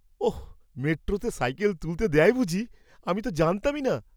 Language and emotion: Bengali, surprised